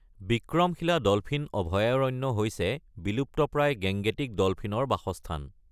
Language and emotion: Assamese, neutral